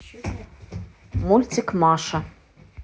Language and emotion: Russian, neutral